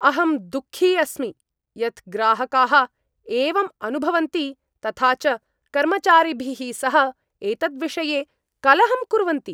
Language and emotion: Sanskrit, angry